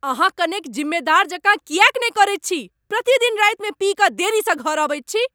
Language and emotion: Maithili, angry